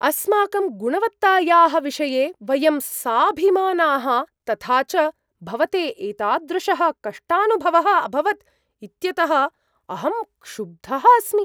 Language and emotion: Sanskrit, surprised